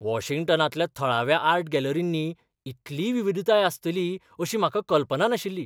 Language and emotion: Goan Konkani, surprised